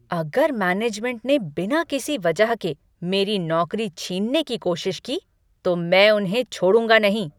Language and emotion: Hindi, angry